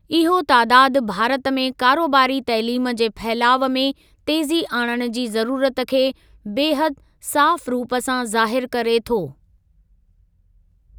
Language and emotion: Sindhi, neutral